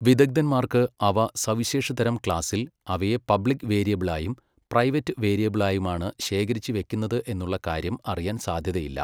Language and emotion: Malayalam, neutral